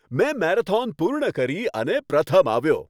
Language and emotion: Gujarati, happy